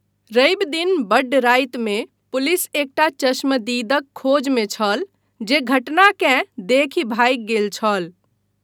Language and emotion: Maithili, neutral